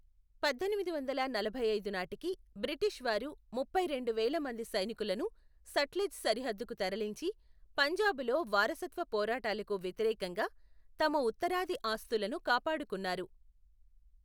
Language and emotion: Telugu, neutral